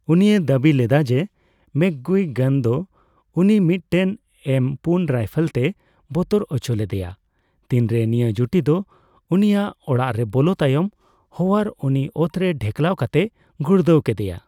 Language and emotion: Santali, neutral